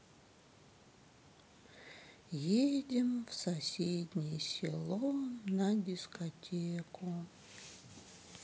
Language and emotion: Russian, sad